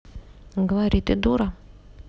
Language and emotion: Russian, neutral